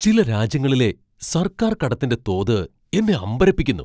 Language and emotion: Malayalam, surprised